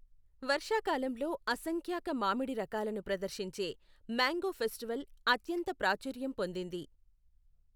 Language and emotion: Telugu, neutral